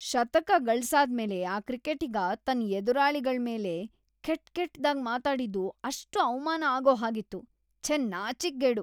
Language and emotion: Kannada, disgusted